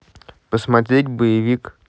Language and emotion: Russian, neutral